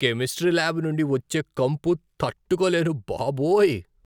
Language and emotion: Telugu, disgusted